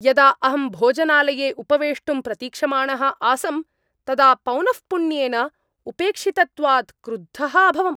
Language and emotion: Sanskrit, angry